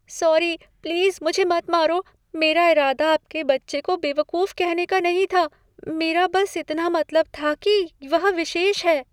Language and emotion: Hindi, fearful